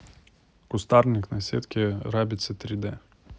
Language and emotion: Russian, neutral